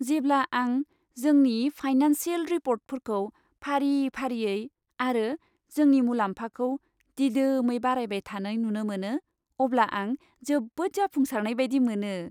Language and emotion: Bodo, happy